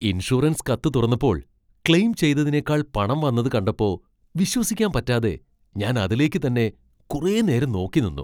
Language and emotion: Malayalam, surprised